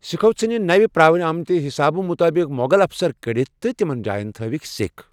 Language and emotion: Kashmiri, neutral